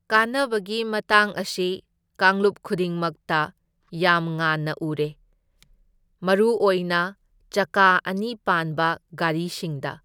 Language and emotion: Manipuri, neutral